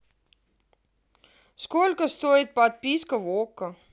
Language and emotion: Russian, angry